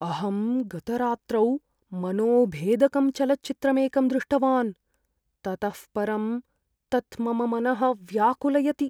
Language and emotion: Sanskrit, fearful